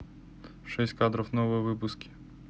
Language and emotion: Russian, neutral